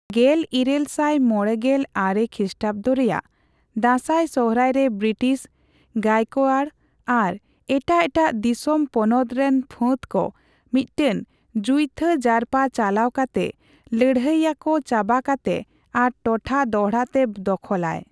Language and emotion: Santali, neutral